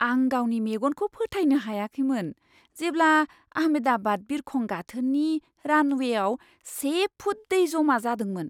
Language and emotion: Bodo, surprised